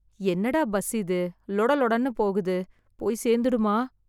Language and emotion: Tamil, fearful